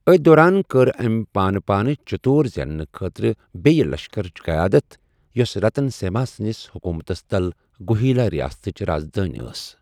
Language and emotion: Kashmiri, neutral